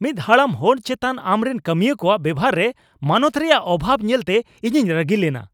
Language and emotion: Santali, angry